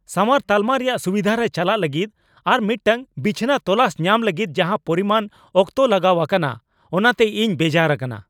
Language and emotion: Santali, angry